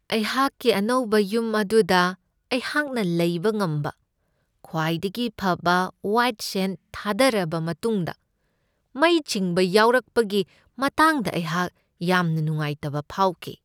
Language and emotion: Manipuri, sad